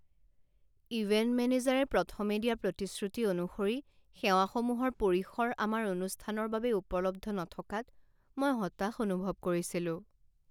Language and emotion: Assamese, sad